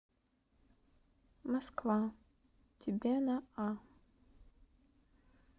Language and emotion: Russian, neutral